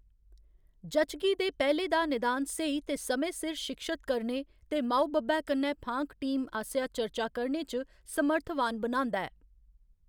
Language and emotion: Dogri, neutral